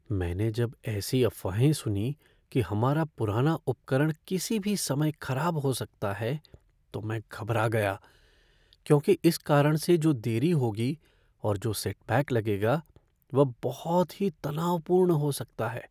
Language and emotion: Hindi, fearful